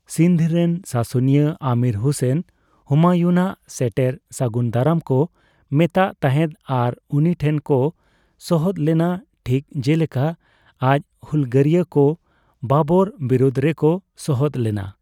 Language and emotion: Santali, neutral